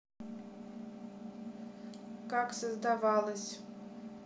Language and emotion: Russian, neutral